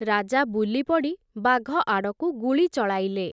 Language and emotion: Odia, neutral